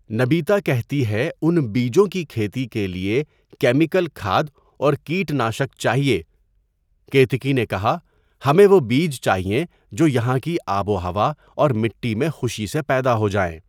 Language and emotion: Urdu, neutral